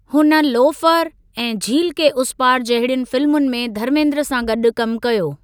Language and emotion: Sindhi, neutral